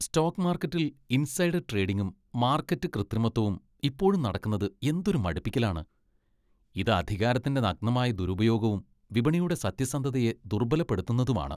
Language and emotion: Malayalam, disgusted